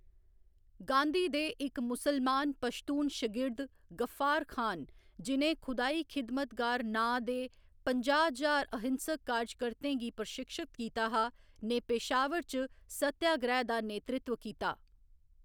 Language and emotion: Dogri, neutral